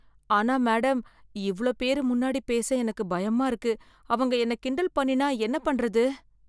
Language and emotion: Tamil, fearful